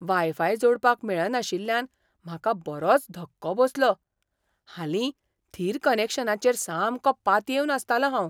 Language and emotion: Goan Konkani, surprised